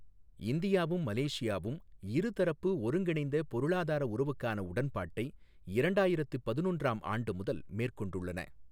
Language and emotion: Tamil, neutral